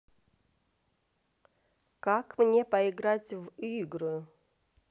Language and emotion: Russian, neutral